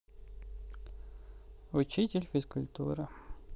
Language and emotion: Russian, neutral